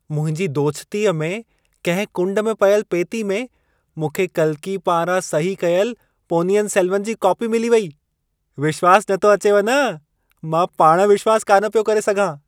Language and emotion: Sindhi, surprised